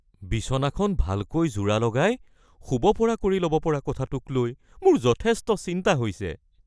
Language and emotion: Assamese, fearful